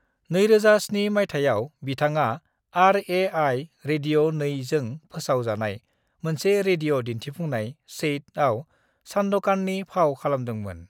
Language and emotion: Bodo, neutral